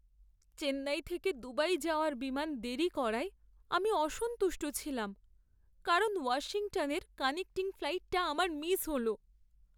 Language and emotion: Bengali, sad